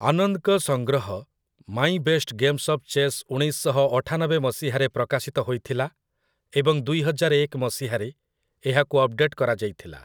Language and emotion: Odia, neutral